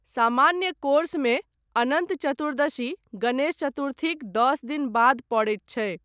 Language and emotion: Maithili, neutral